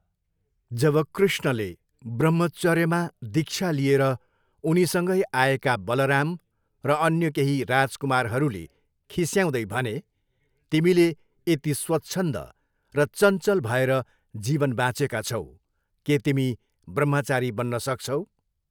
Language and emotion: Nepali, neutral